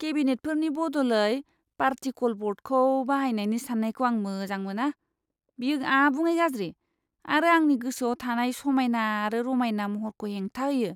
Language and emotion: Bodo, disgusted